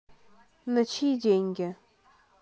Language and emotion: Russian, neutral